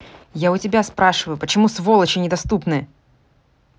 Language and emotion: Russian, angry